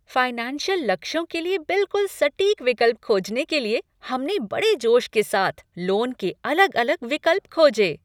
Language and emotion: Hindi, happy